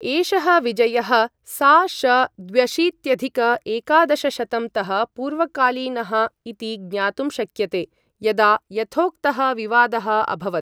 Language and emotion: Sanskrit, neutral